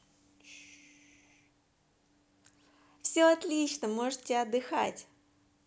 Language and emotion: Russian, positive